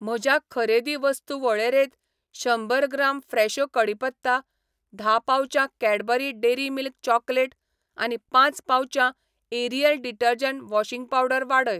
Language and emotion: Goan Konkani, neutral